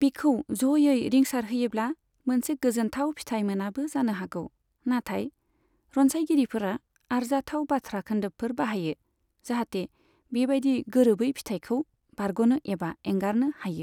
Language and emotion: Bodo, neutral